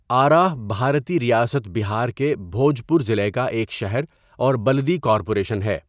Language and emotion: Urdu, neutral